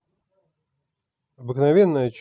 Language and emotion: Russian, neutral